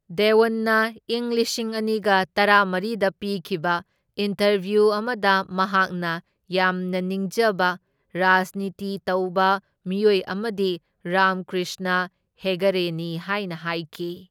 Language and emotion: Manipuri, neutral